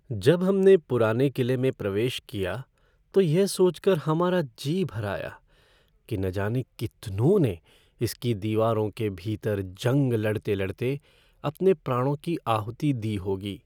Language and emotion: Hindi, sad